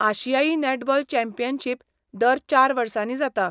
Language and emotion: Goan Konkani, neutral